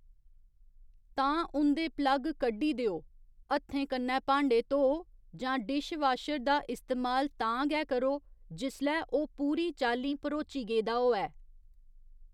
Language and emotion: Dogri, neutral